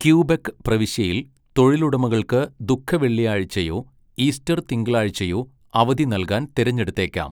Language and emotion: Malayalam, neutral